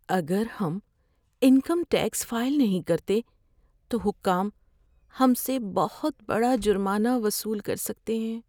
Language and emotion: Urdu, fearful